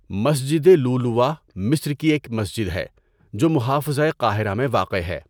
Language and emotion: Urdu, neutral